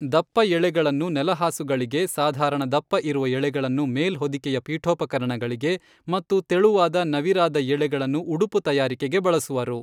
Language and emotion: Kannada, neutral